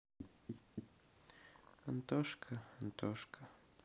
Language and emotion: Russian, sad